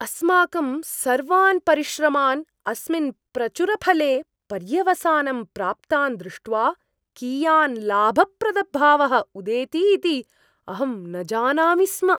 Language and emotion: Sanskrit, surprised